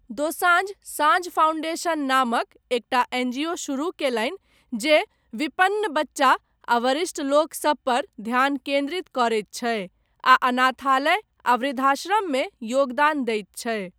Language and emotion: Maithili, neutral